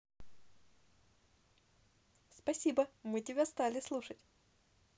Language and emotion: Russian, positive